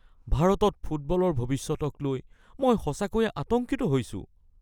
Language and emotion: Assamese, fearful